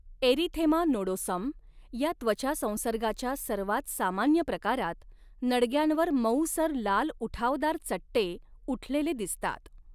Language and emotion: Marathi, neutral